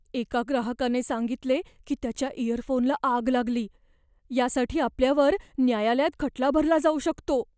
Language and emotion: Marathi, fearful